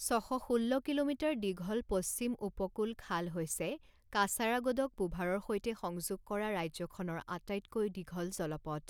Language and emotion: Assamese, neutral